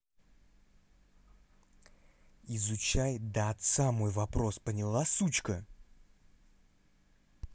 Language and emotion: Russian, angry